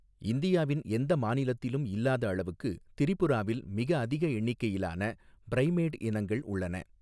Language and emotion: Tamil, neutral